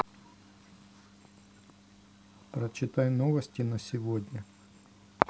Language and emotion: Russian, neutral